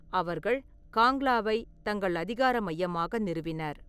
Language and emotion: Tamil, neutral